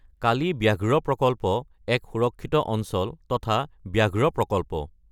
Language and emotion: Assamese, neutral